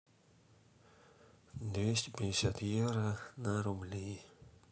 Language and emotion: Russian, sad